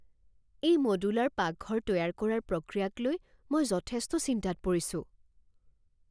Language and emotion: Assamese, fearful